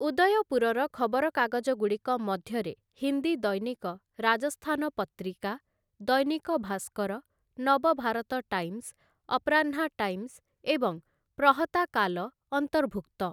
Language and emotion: Odia, neutral